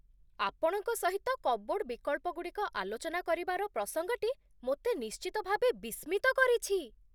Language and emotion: Odia, surprised